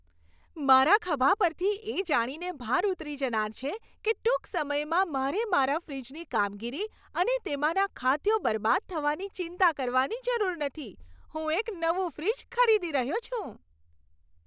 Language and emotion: Gujarati, happy